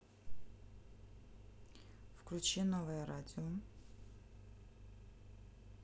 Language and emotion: Russian, neutral